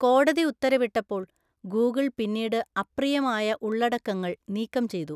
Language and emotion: Malayalam, neutral